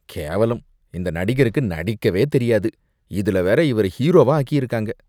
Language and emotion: Tamil, disgusted